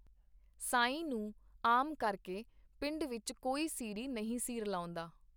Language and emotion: Punjabi, neutral